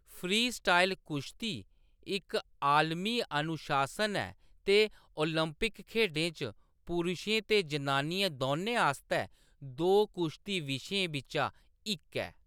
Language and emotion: Dogri, neutral